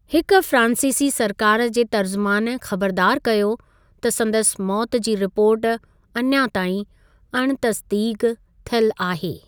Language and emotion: Sindhi, neutral